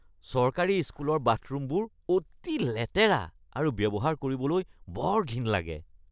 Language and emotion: Assamese, disgusted